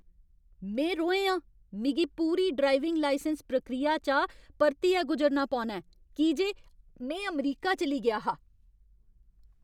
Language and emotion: Dogri, angry